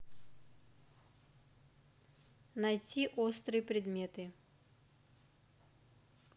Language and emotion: Russian, neutral